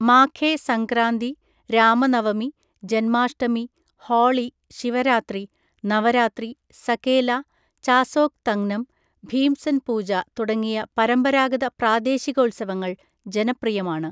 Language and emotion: Malayalam, neutral